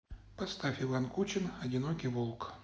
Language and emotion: Russian, neutral